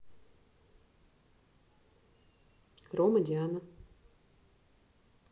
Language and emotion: Russian, neutral